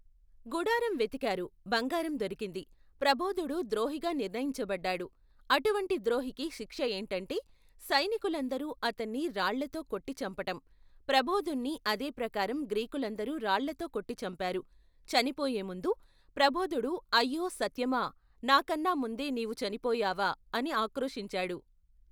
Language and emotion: Telugu, neutral